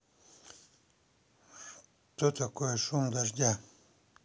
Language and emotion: Russian, neutral